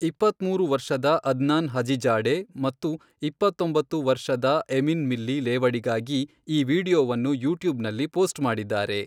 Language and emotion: Kannada, neutral